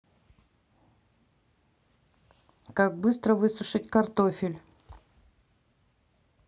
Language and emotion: Russian, neutral